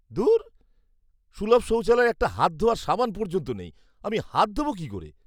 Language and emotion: Bengali, disgusted